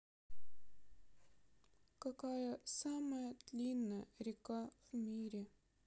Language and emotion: Russian, sad